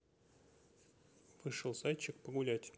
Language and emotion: Russian, neutral